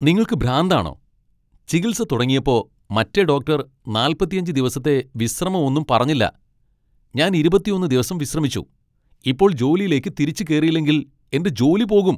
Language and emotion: Malayalam, angry